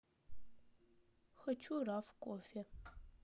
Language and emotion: Russian, sad